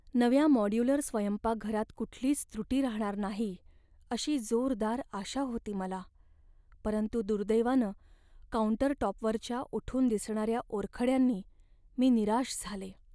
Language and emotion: Marathi, sad